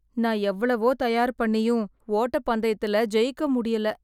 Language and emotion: Tamil, sad